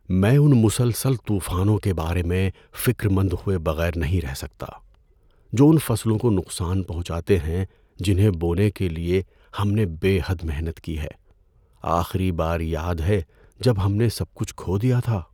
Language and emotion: Urdu, fearful